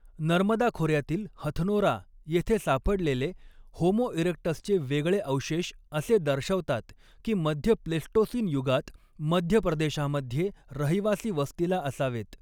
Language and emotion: Marathi, neutral